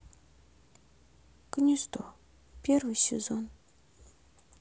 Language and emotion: Russian, sad